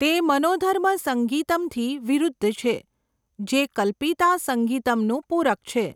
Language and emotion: Gujarati, neutral